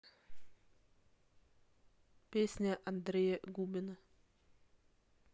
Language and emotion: Russian, neutral